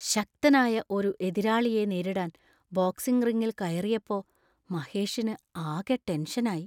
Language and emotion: Malayalam, fearful